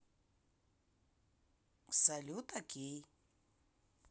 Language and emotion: Russian, neutral